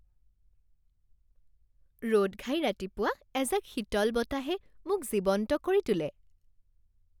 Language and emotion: Assamese, happy